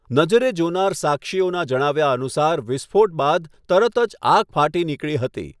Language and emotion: Gujarati, neutral